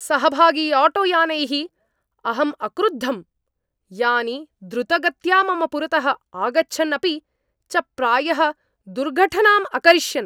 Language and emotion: Sanskrit, angry